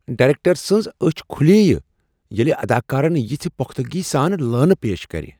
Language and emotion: Kashmiri, surprised